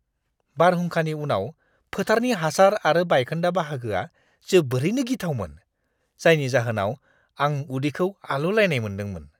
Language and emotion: Bodo, disgusted